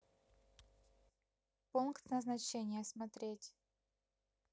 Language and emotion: Russian, neutral